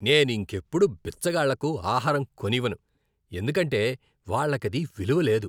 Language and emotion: Telugu, disgusted